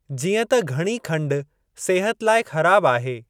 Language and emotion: Sindhi, neutral